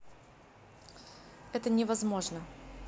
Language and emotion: Russian, neutral